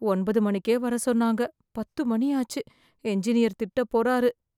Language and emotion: Tamil, fearful